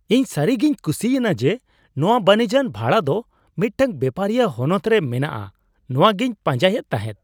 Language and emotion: Santali, surprised